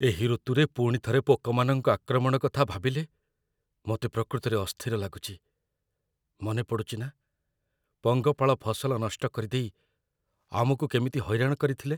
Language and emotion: Odia, fearful